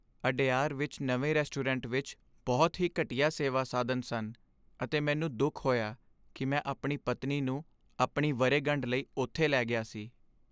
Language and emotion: Punjabi, sad